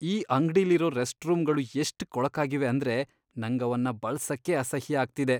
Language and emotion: Kannada, disgusted